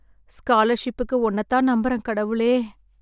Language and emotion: Tamil, sad